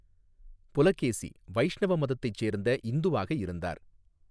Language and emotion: Tamil, neutral